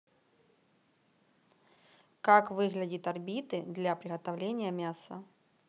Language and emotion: Russian, neutral